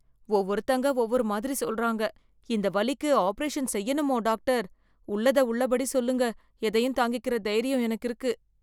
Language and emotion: Tamil, fearful